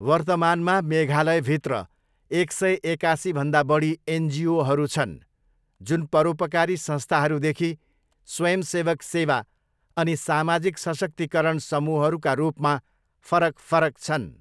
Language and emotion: Nepali, neutral